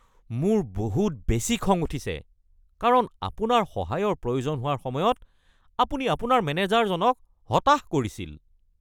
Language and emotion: Assamese, angry